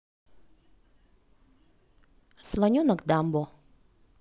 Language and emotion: Russian, neutral